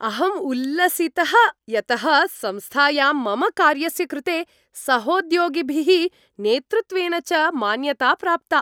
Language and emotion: Sanskrit, happy